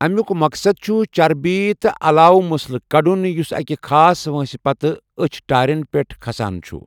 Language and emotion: Kashmiri, neutral